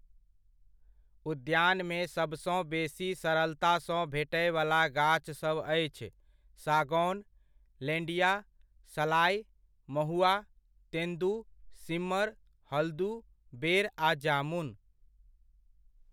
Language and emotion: Maithili, neutral